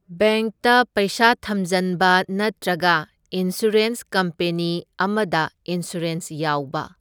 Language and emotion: Manipuri, neutral